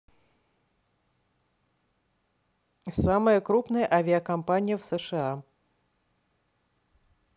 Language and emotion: Russian, neutral